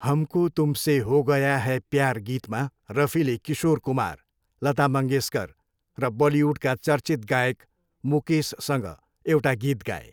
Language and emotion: Nepali, neutral